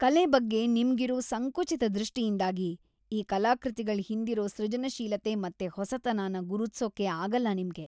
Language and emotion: Kannada, disgusted